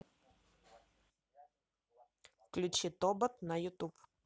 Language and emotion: Russian, neutral